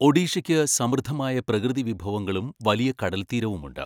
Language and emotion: Malayalam, neutral